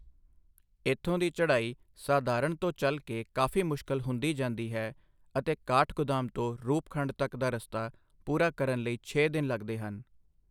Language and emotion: Punjabi, neutral